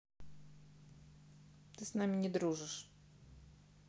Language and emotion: Russian, sad